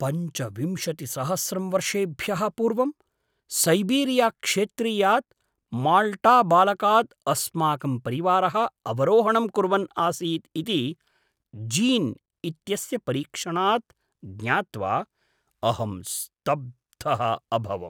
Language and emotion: Sanskrit, surprised